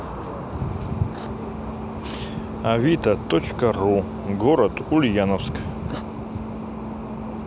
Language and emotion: Russian, neutral